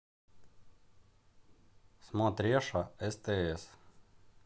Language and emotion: Russian, neutral